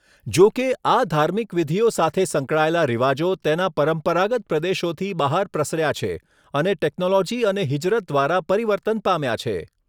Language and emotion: Gujarati, neutral